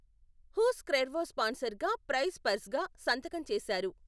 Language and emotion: Telugu, neutral